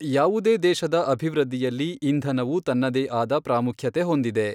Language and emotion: Kannada, neutral